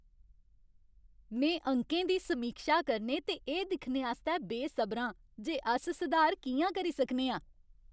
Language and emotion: Dogri, happy